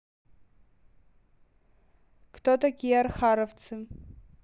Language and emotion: Russian, neutral